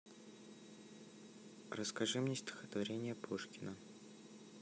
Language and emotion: Russian, neutral